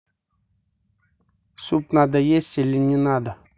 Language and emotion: Russian, neutral